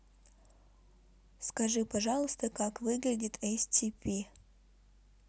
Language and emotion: Russian, neutral